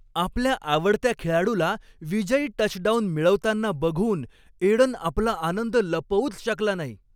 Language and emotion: Marathi, happy